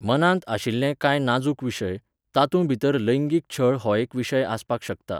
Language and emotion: Goan Konkani, neutral